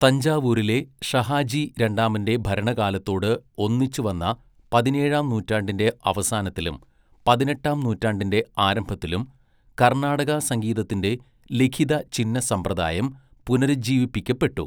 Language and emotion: Malayalam, neutral